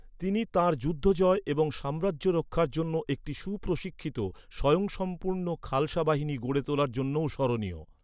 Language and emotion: Bengali, neutral